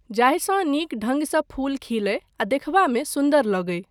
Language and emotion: Maithili, neutral